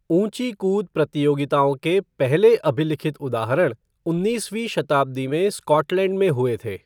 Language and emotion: Hindi, neutral